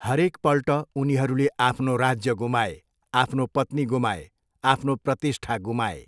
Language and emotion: Nepali, neutral